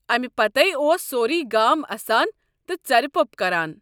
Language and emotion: Kashmiri, neutral